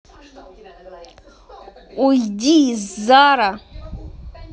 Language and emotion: Russian, angry